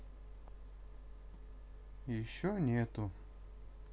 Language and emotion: Russian, neutral